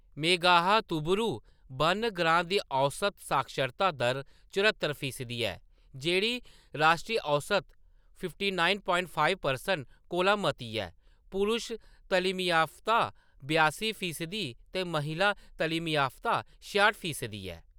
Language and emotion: Dogri, neutral